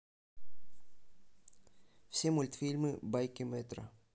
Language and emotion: Russian, neutral